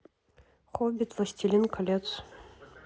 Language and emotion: Russian, neutral